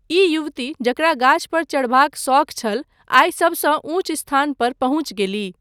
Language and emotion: Maithili, neutral